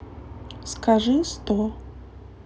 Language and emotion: Russian, neutral